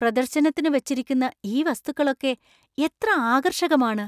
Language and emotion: Malayalam, surprised